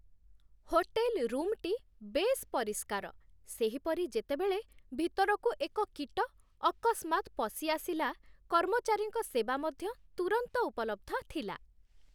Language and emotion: Odia, happy